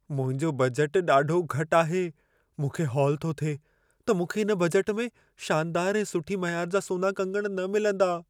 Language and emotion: Sindhi, fearful